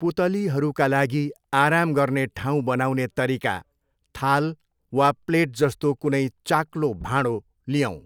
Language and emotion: Nepali, neutral